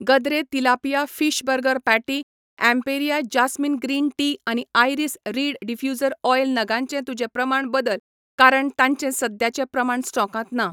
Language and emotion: Goan Konkani, neutral